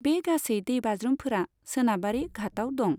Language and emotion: Bodo, neutral